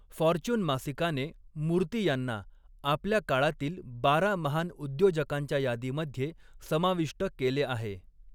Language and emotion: Marathi, neutral